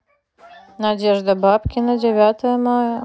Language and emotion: Russian, neutral